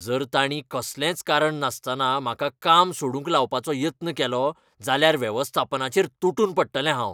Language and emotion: Goan Konkani, angry